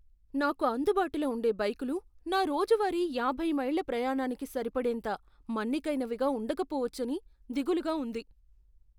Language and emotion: Telugu, fearful